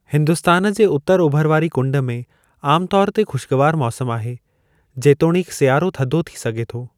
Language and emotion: Sindhi, neutral